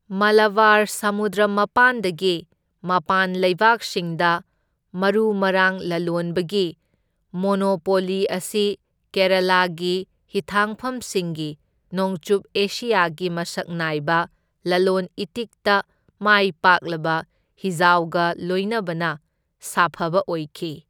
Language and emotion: Manipuri, neutral